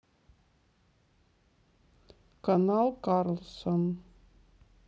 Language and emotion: Russian, sad